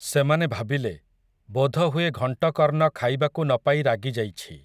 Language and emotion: Odia, neutral